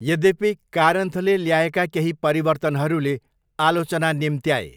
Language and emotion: Nepali, neutral